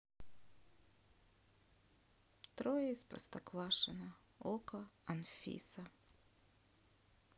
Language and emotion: Russian, sad